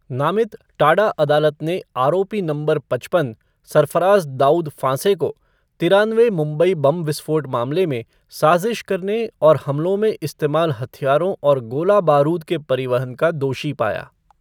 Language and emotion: Hindi, neutral